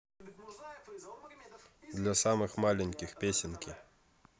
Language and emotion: Russian, neutral